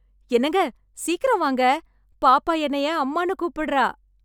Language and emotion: Tamil, happy